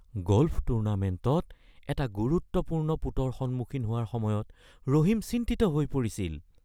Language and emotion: Assamese, fearful